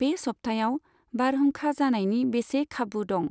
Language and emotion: Bodo, neutral